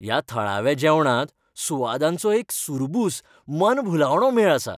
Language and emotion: Goan Konkani, happy